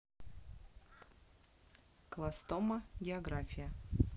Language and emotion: Russian, neutral